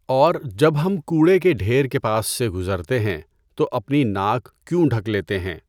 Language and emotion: Urdu, neutral